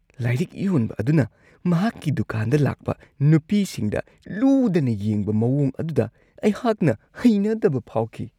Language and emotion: Manipuri, disgusted